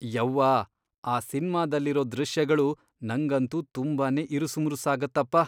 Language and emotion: Kannada, disgusted